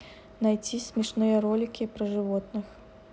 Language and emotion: Russian, neutral